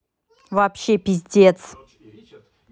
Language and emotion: Russian, angry